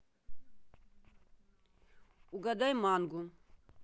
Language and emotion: Russian, neutral